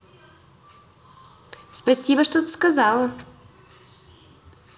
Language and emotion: Russian, positive